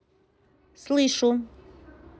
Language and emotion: Russian, neutral